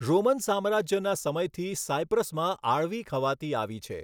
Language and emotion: Gujarati, neutral